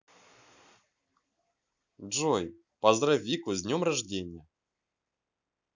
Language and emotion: Russian, positive